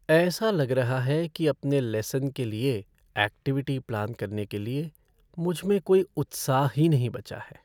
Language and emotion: Hindi, sad